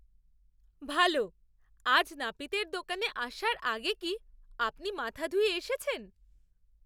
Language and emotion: Bengali, surprised